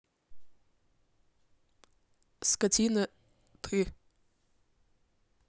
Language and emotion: Russian, neutral